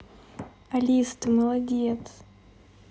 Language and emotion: Russian, positive